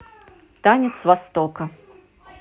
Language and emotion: Russian, positive